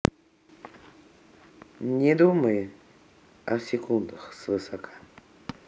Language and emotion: Russian, neutral